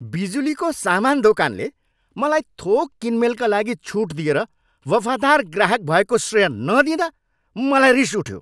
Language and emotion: Nepali, angry